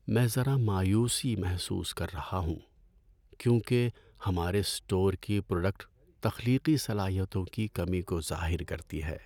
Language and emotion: Urdu, sad